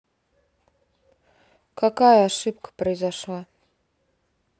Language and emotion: Russian, neutral